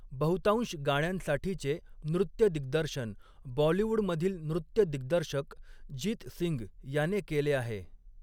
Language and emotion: Marathi, neutral